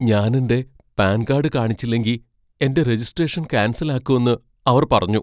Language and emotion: Malayalam, fearful